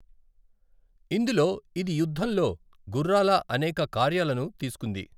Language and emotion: Telugu, neutral